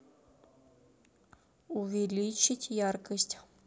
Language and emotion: Russian, neutral